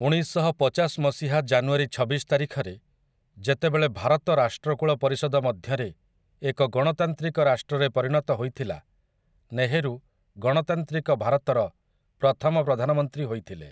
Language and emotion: Odia, neutral